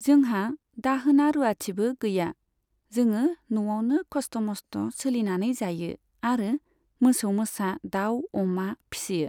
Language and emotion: Bodo, neutral